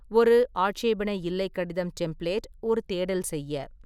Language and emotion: Tamil, neutral